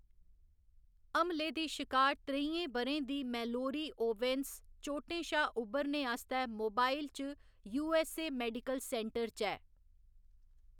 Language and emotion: Dogri, neutral